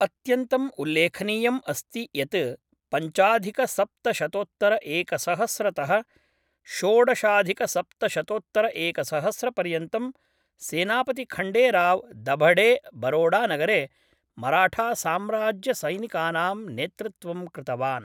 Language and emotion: Sanskrit, neutral